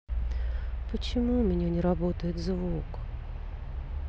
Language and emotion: Russian, sad